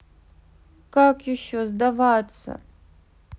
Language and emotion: Russian, sad